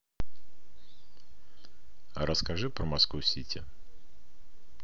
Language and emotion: Russian, neutral